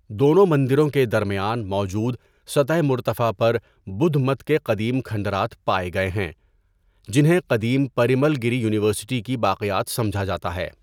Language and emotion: Urdu, neutral